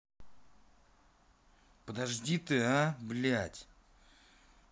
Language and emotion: Russian, angry